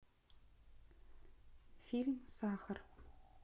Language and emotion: Russian, neutral